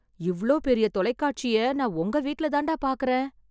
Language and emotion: Tamil, surprised